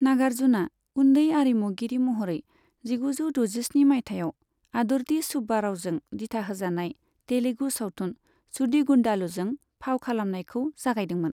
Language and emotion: Bodo, neutral